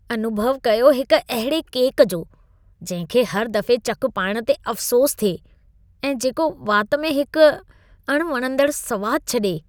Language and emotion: Sindhi, disgusted